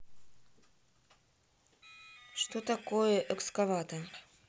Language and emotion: Russian, neutral